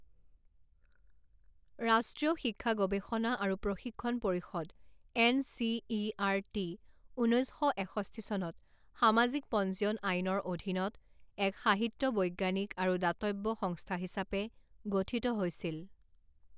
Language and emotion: Assamese, neutral